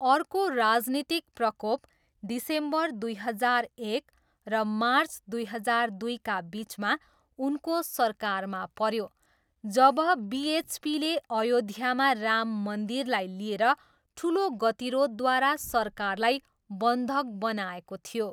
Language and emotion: Nepali, neutral